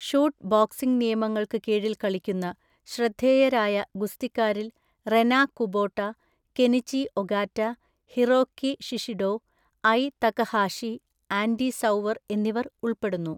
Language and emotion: Malayalam, neutral